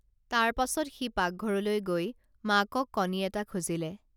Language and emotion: Assamese, neutral